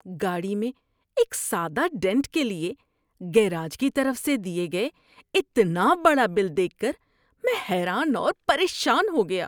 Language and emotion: Urdu, disgusted